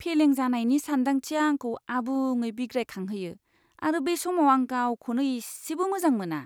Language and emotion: Bodo, disgusted